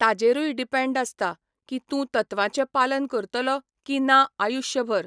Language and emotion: Goan Konkani, neutral